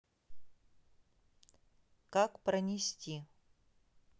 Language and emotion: Russian, neutral